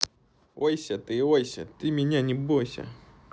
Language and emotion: Russian, neutral